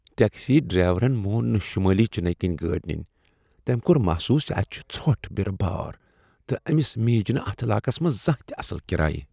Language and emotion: Kashmiri, disgusted